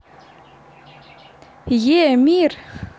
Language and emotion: Russian, positive